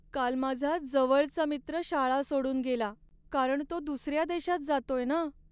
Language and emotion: Marathi, sad